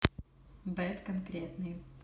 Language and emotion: Russian, neutral